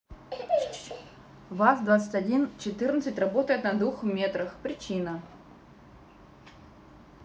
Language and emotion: Russian, neutral